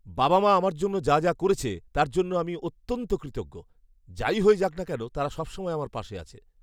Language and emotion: Bengali, happy